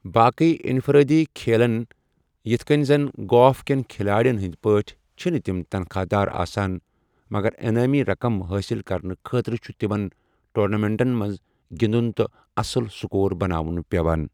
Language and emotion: Kashmiri, neutral